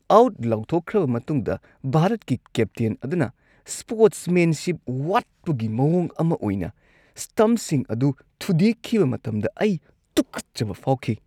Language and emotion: Manipuri, disgusted